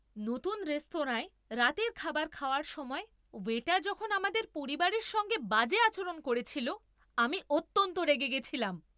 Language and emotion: Bengali, angry